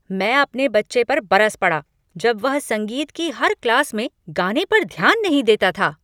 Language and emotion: Hindi, angry